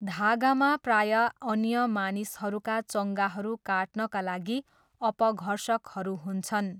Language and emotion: Nepali, neutral